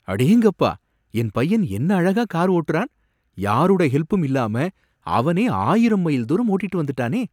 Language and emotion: Tamil, surprised